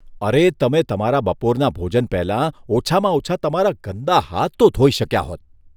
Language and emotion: Gujarati, disgusted